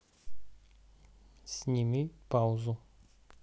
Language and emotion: Russian, neutral